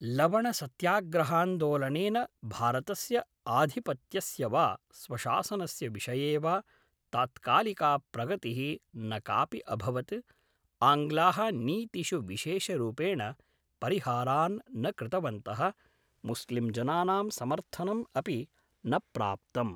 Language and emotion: Sanskrit, neutral